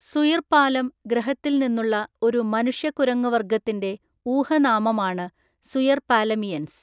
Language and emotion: Malayalam, neutral